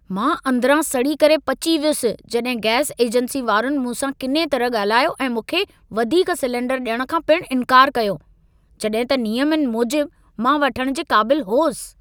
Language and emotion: Sindhi, angry